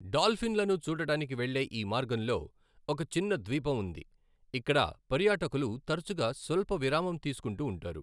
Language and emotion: Telugu, neutral